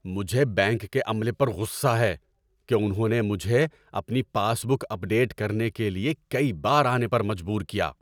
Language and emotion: Urdu, angry